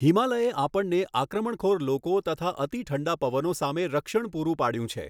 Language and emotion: Gujarati, neutral